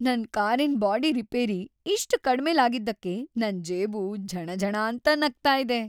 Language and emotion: Kannada, happy